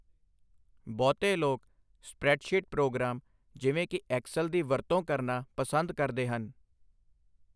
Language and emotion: Punjabi, neutral